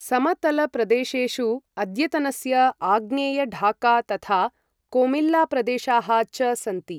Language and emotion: Sanskrit, neutral